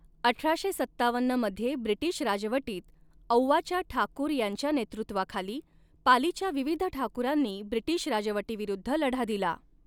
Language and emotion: Marathi, neutral